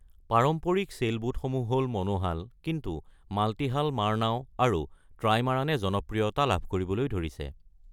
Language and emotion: Assamese, neutral